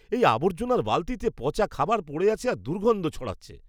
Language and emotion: Bengali, disgusted